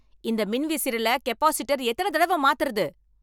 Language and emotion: Tamil, angry